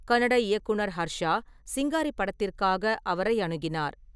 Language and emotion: Tamil, neutral